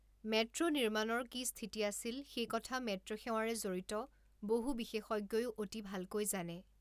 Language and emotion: Assamese, neutral